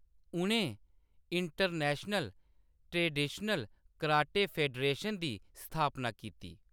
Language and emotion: Dogri, neutral